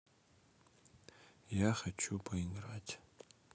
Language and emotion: Russian, neutral